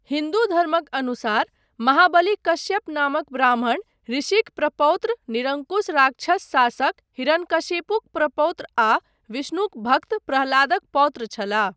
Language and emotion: Maithili, neutral